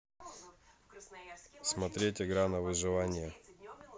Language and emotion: Russian, neutral